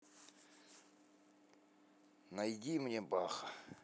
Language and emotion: Russian, neutral